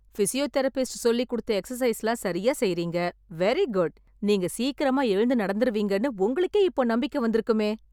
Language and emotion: Tamil, happy